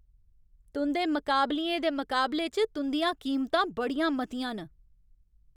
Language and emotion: Dogri, angry